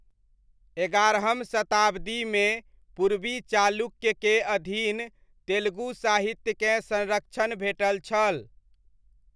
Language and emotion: Maithili, neutral